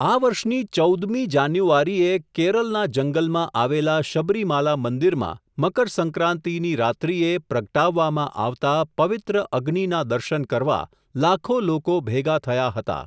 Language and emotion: Gujarati, neutral